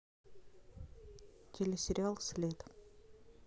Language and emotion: Russian, neutral